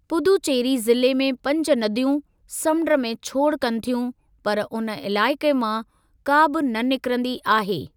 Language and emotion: Sindhi, neutral